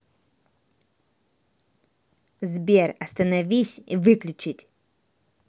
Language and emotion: Russian, angry